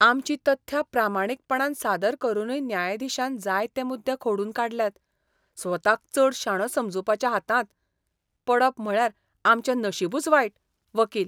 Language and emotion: Goan Konkani, disgusted